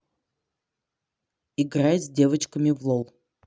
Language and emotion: Russian, neutral